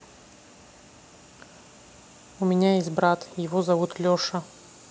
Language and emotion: Russian, neutral